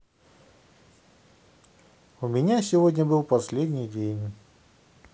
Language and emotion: Russian, neutral